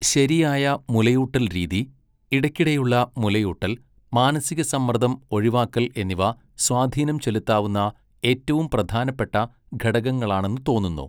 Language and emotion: Malayalam, neutral